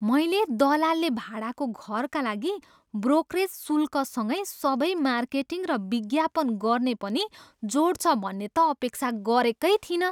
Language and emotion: Nepali, surprised